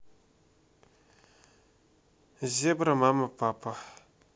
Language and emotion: Russian, neutral